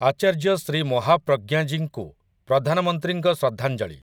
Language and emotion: Odia, neutral